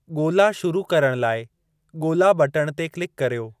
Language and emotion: Sindhi, neutral